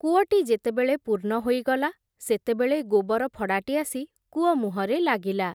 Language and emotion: Odia, neutral